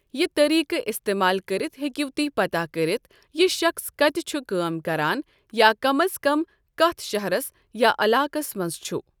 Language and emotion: Kashmiri, neutral